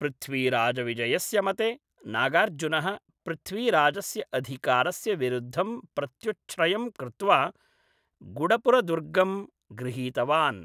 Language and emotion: Sanskrit, neutral